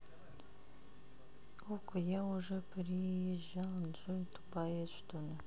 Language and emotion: Russian, neutral